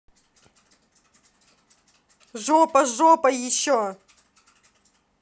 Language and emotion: Russian, angry